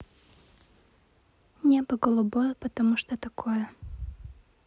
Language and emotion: Russian, neutral